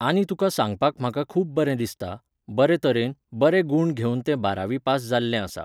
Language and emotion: Goan Konkani, neutral